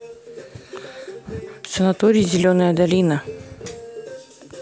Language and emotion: Russian, neutral